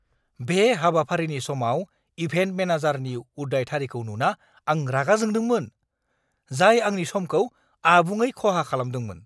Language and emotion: Bodo, angry